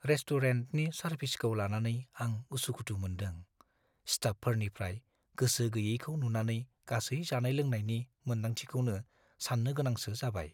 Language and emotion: Bodo, fearful